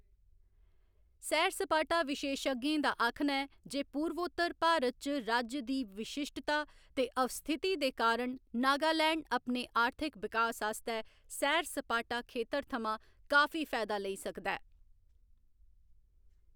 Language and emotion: Dogri, neutral